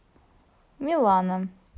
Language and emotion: Russian, neutral